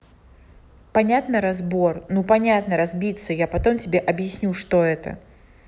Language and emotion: Russian, neutral